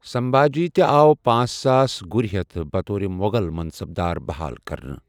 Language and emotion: Kashmiri, neutral